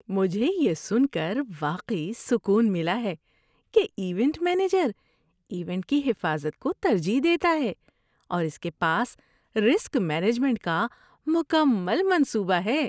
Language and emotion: Urdu, happy